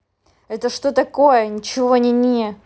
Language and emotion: Russian, angry